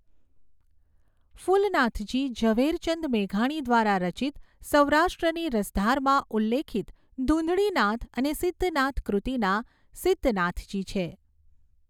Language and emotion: Gujarati, neutral